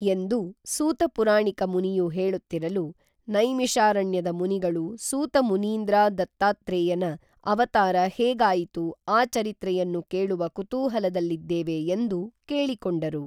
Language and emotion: Kannada, neutral